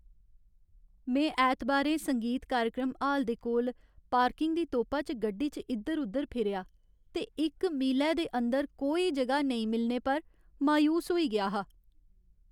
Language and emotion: Dogri, sad